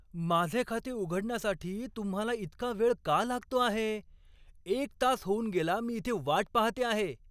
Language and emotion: Marathi, angry